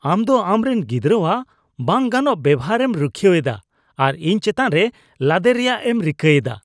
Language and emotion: Santali, disgusted